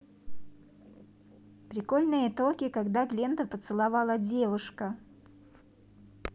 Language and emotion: Russian, positive